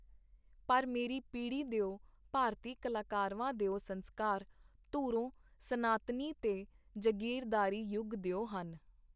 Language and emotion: Punjabi, neutral